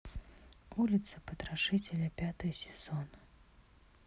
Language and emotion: Russian, sad